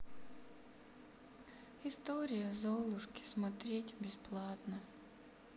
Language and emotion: Russian, sad